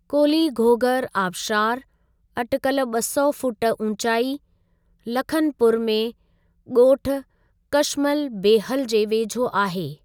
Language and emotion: Sindhi, neutral